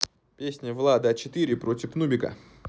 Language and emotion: Russian, positive